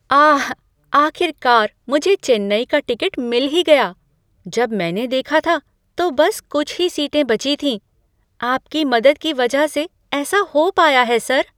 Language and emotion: Hindi, surprised